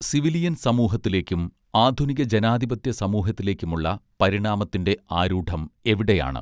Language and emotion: Malayalam, neutral